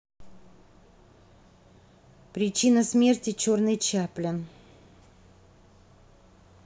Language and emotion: Russian, neutral